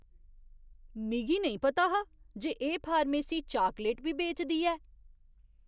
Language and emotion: Dogri, surprised